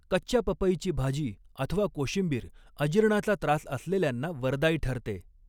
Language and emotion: Marathi, neutral